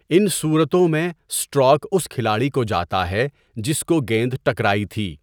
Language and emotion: Urdu, neutral